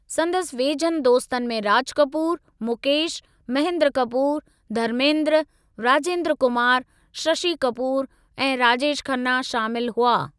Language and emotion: Sindhi, neutral